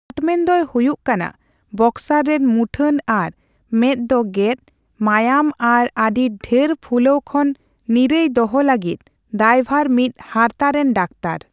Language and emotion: Santali, neutral